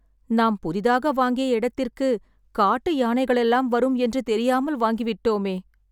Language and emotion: Tamil, sad